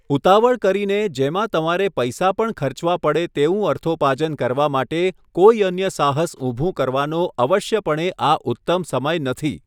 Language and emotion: Gujarati, neutral